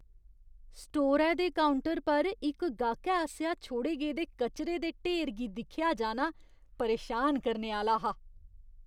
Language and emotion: Dogri, disgusted